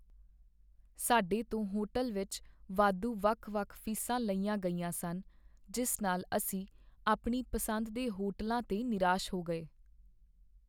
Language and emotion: Punjabi, sad